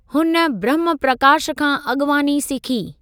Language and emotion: Sindhi, neutral